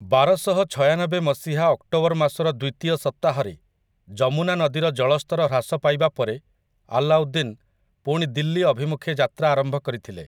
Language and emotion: Odia, neutral